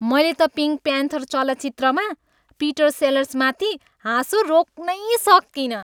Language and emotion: Nepali, happy